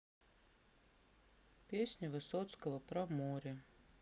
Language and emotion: Russian, sad